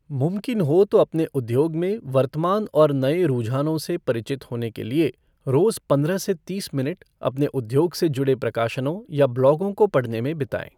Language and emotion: Hindi, neutral